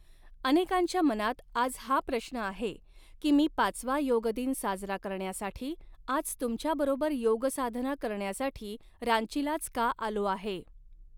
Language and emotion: Marathi, neutral